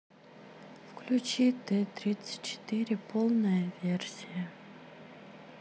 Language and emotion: Russian, sad